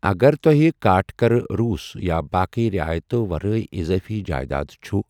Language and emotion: Kashmiri, neutral